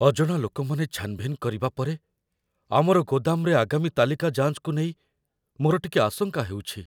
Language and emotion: Odia, fearful